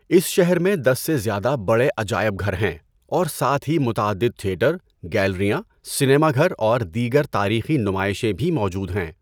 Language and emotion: Urdu, neutral